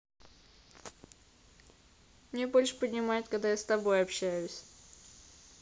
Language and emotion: Russian, neutral